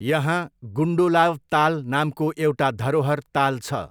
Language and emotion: Nepali, neutral